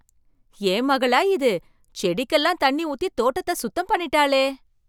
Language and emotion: Tamil, surprised